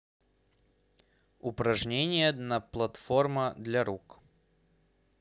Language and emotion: Russian, neutral